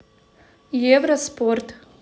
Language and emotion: Russian, neutral